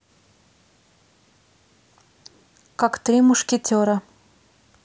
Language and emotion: Russian, neutral